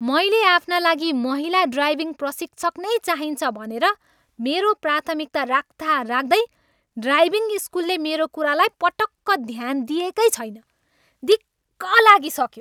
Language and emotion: Nepali, angry